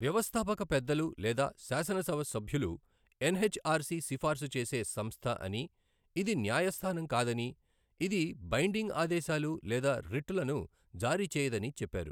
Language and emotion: Telugu, neutral